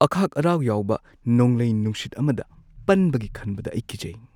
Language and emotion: Manipuri, fearful